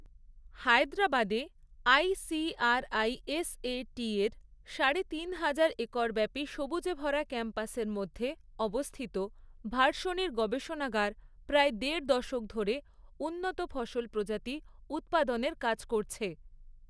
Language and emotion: Bengali, neutral